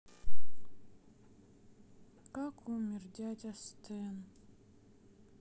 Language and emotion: Russian, sad